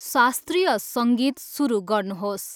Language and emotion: Nepali, neutral